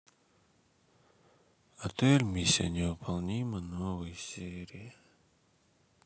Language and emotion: Russian, sad